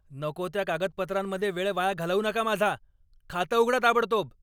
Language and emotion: Marathi, angry